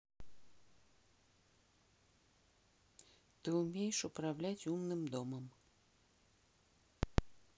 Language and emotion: Russian, neutral